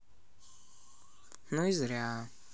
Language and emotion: Russian, neutral